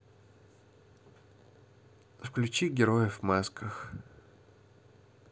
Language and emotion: Russian, neutral